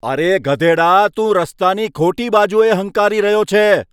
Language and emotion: Gujarati, angry